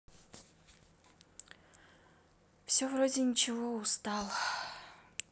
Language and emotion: Russian, sad